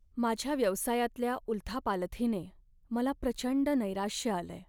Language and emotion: Marathi, sad